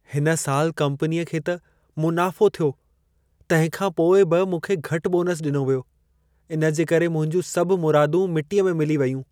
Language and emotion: Sindhi, sad